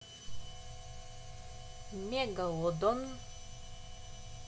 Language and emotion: Russian, neutral